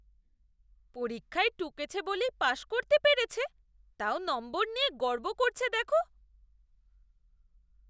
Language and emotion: Bengali, disgusted